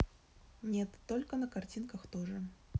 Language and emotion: Russian, neutral